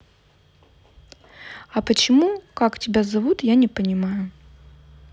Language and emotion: Russian, neutral